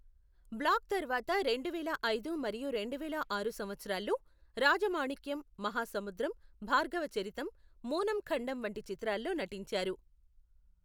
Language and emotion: Telugu, neutral